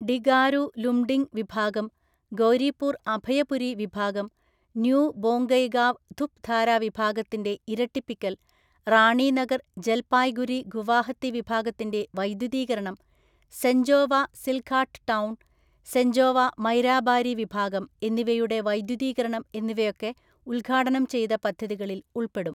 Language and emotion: Malayalam, neutral